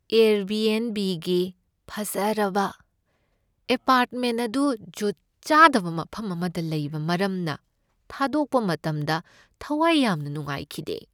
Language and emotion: Manipuri, sad